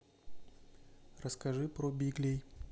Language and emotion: Russian, neutral